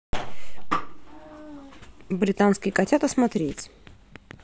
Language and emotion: Russian, positive